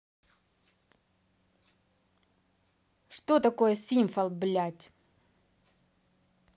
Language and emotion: Russian, angry